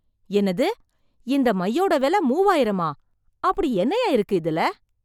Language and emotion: Tamil, surprised